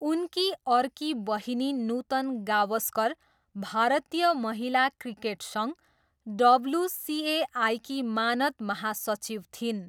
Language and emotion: Nepali, neutral